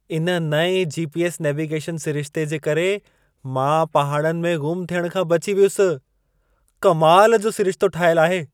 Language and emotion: Sindhi, surprised